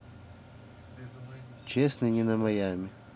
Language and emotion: Russian, neutral